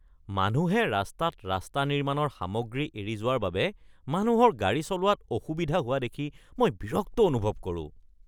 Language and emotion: Assamese, disgusted